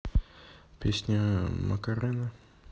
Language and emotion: Russian, neutral